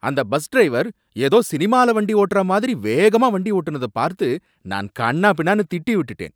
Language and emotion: Tamil, angry